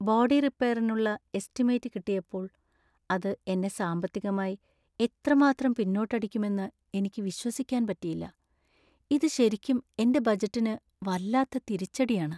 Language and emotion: Malayalam, sad